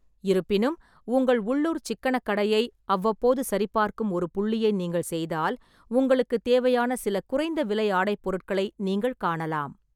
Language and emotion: Tamil, neutral